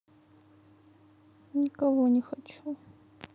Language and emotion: Russian, sad